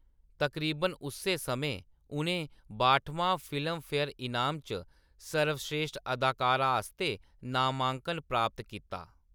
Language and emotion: Dogri, neutral